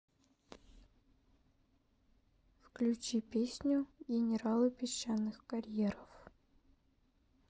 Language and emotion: Russian, neutral